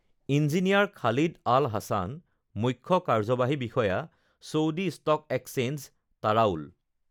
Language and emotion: Assamese, neutral